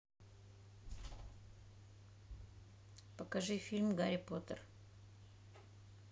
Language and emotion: Russian, neutral